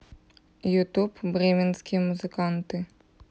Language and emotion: Russian, neutral